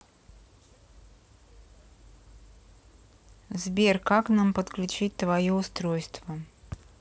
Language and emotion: Russian, neutral